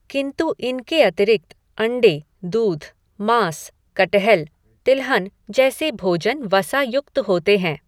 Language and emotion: Hindi, neutral